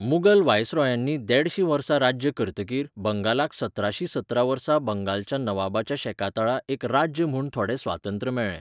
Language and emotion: Goan Konkani, neutral